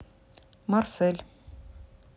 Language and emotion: Russian, neutral